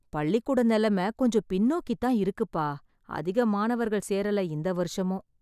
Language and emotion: Tamil, sad